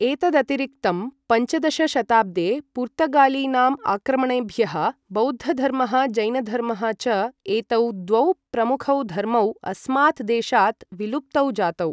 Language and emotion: Sanskrit, neutral